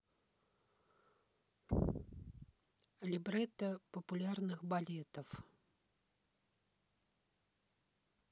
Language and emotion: Russian, neutral